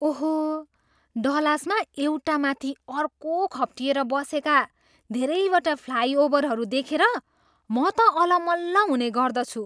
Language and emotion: Nepali, surprised